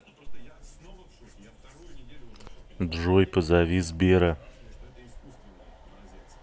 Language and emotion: Russian, neutral